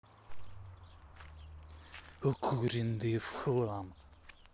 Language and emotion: Russian, angry